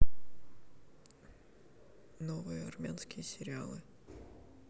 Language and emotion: Russian, neutral